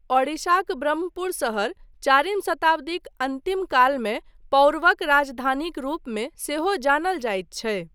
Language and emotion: Maithili, neutral